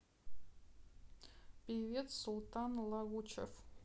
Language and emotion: Russian, neutral